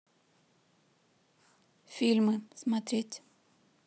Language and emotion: Russian, neutral